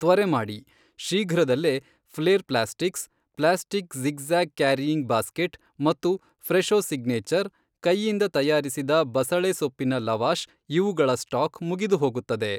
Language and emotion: Kannada, neutral